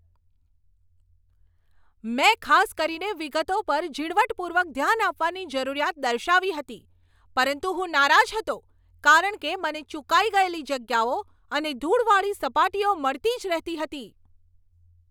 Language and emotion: Gujarati, angry